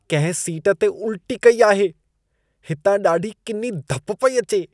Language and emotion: Sindhi, disgusted